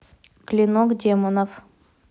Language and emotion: Russian, neutral